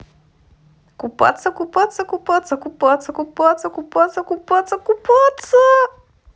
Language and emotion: Russian, positive